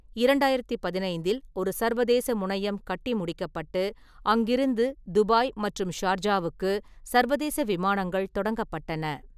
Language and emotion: Tamil, neutral